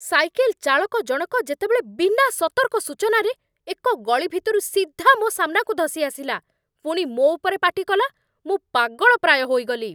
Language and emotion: Odia, angry